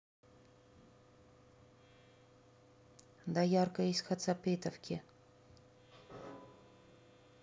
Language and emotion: Russian, neutral